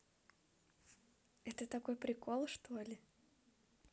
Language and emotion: Russian, positive